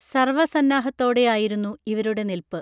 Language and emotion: Malayalam, neutral